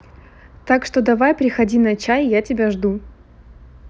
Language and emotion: Russian, neutral